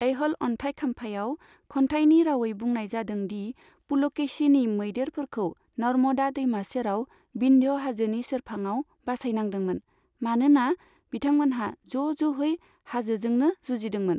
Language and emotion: Bodo, neutral